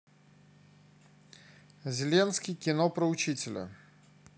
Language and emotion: Russian, neutral